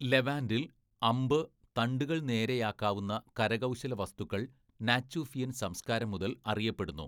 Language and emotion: Malayalam, neutral